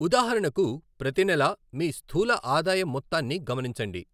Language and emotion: Telugu, neutral